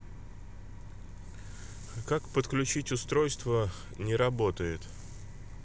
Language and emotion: Russian, neutral